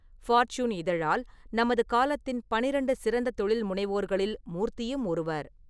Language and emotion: Tamil, neutral